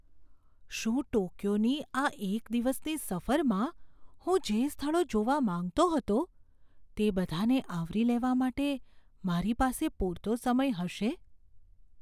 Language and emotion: Gujarati, fearful